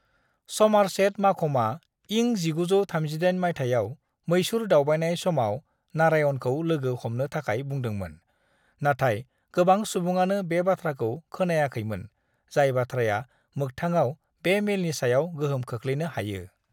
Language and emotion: Bodo, neutral